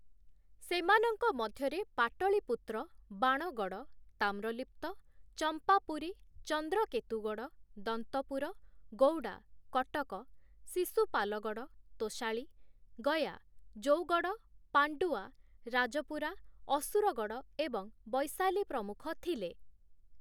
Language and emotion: Odia, neutral